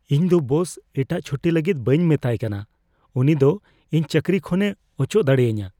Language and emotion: Santali, fearful